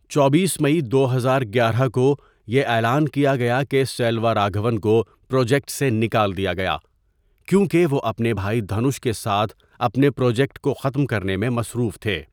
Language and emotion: Urdu, neutral